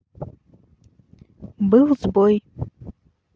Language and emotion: Russian, neutral